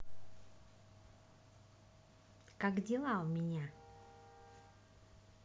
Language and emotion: Russian, positive